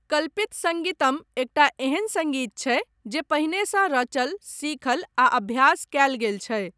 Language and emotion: Maithili, neutral